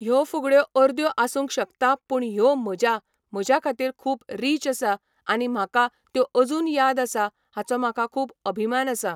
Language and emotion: Goan Konkani, neutral